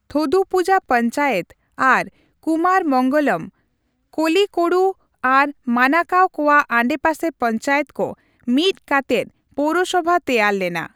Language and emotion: Santali, neutral